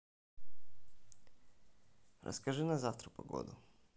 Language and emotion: Russian, neutral